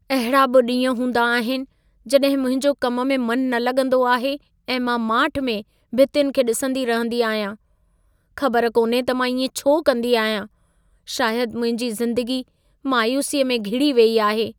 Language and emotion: Sindhi, sad